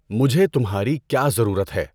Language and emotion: Urdu, neutral